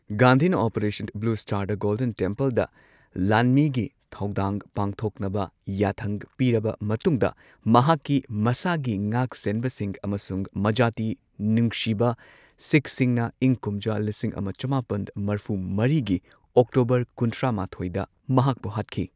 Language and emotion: Manipuri, neutral